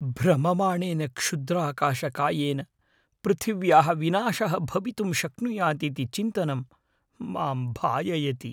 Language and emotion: Sanskrit, fearful